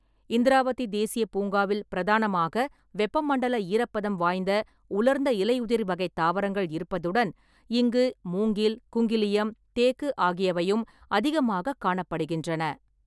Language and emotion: Tamil, neutral